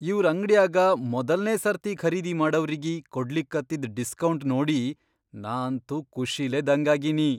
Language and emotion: Kannada, surprised